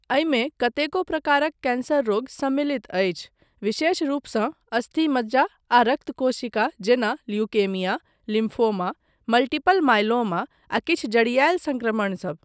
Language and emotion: Maithili, neutral